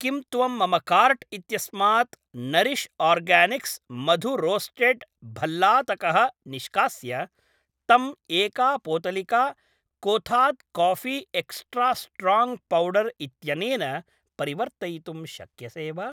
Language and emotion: Sanskrit, neutral